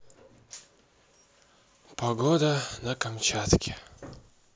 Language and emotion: Russian, sad